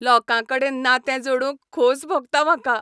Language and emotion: Goan Konkani, happy